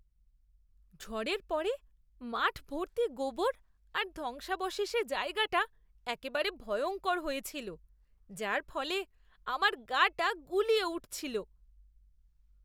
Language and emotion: Bengali, disgusted